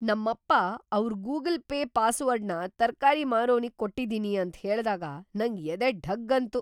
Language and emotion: Kannada, surprised